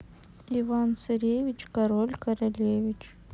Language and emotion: Russian, neutral